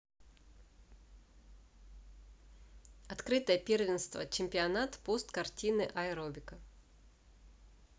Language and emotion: Russian, neutral